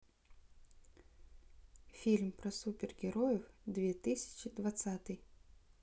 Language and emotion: Russian, neutral